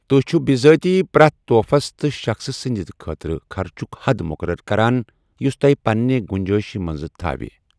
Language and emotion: Kashmiri, neutral